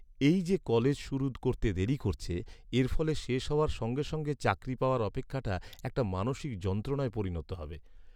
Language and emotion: Bengali, sad